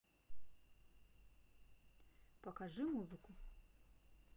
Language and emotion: Russian, neutral